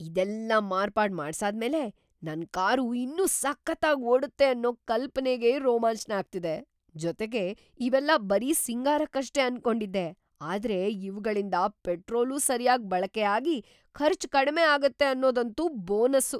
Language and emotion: Kannada, surprised